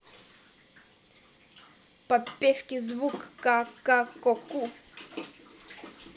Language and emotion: Russian, positive